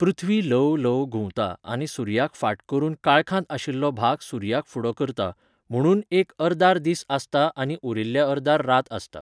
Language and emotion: Goan Konkani, neutral